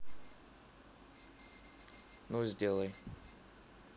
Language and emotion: Russian, neutral